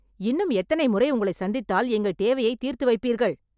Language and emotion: Tamil, angry